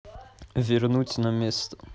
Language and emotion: Russian, neutral